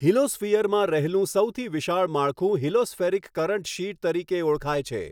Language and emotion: Gujarati, neutral